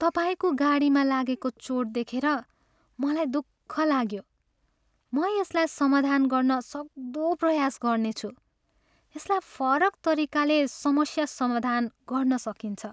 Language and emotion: Nepali, sad